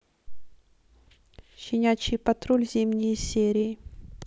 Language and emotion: Russian, neutral